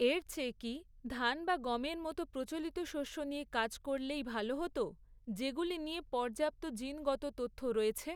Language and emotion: Bengali, neutral